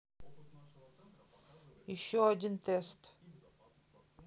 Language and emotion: Russian, neutral